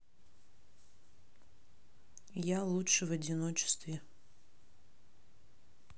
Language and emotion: Russian, sad